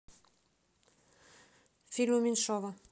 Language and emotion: Russian, neutral